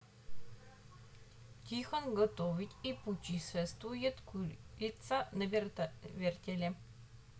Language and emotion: Russian, neutral